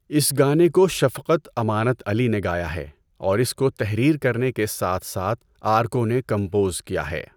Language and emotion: Urdu, neutral